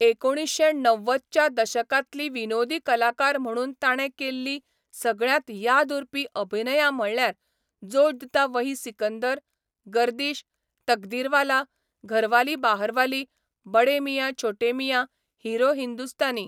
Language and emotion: Goan Konkani, neutral